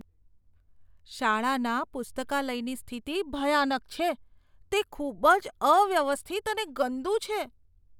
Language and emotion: Gujarati, disgusted